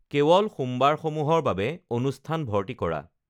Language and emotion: Assamese, neutral